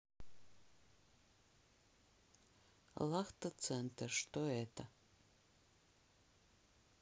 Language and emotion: Russian, neutral